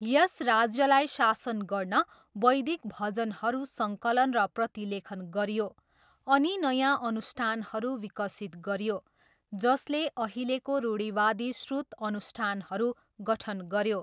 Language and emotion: Nepali, neutral